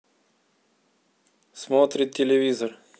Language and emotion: Russian, neutral